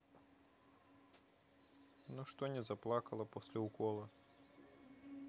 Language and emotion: Russian, neutral